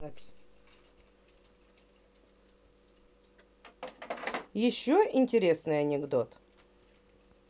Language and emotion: Russian, neutral